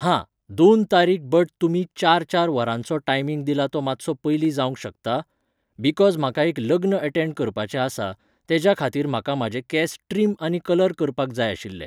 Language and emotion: Goan Konkani, neutral